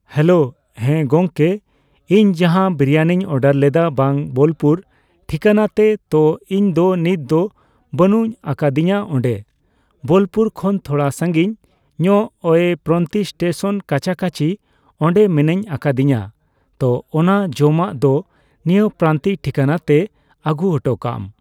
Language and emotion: Santali, neutral